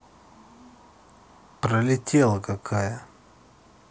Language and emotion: Russian, neutral